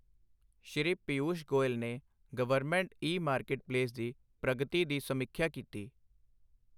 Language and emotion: Punjabi, neutral